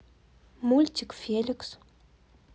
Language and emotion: Russian, neutral